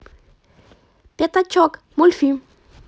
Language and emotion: Russian, positive